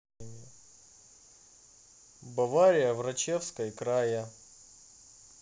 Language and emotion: Russian, neutral